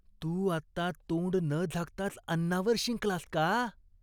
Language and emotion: Marathi, disgusted